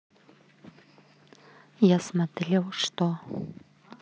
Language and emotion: Russian, neutral